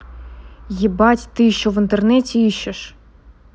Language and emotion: Russian, angry